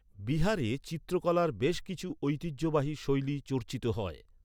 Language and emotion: Bengali, neutral